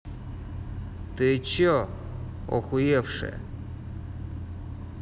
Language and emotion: Russian, angry